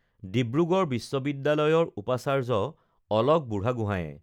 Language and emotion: Assamese, neutral